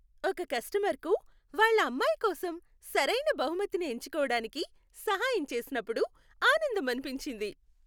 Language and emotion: Telugu, happy